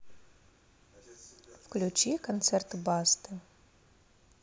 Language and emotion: Russian, neutral